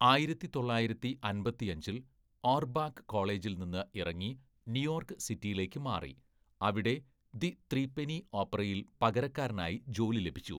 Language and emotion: Malayalam, neutral